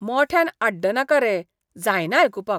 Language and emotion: Goan Konkani, disgusted